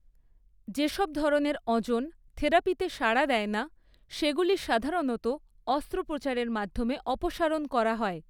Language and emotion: Bengali, neutral